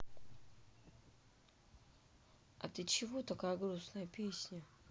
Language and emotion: Russian, sad